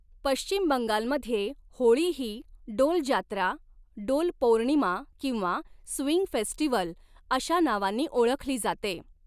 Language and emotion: Marathi, neutral